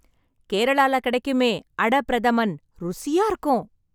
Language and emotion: Tamil, happy